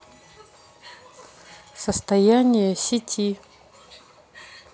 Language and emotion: Russian, neutral